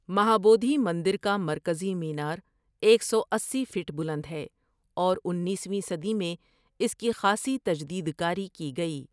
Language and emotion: Urdu, neutral